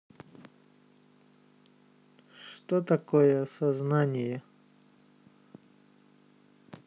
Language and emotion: Russian, neutral